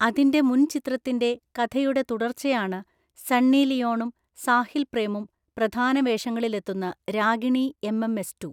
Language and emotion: Malayalam, neutral